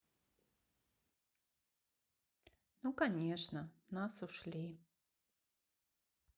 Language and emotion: Russian, sad